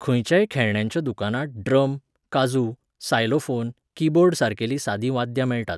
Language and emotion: Goan Konkani, neutral